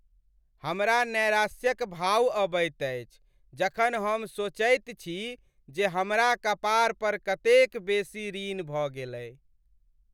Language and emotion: Maithili, sad